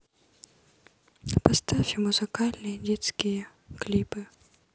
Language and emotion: Russian, sad